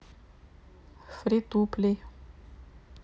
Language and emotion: Russian, neutral